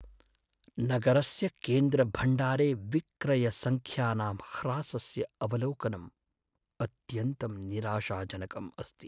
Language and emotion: Sanskrit, sad